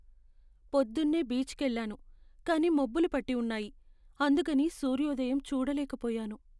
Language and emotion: Telugu, sad